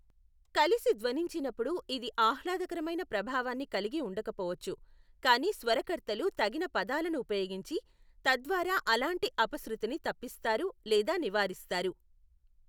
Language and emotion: Telugu, neutral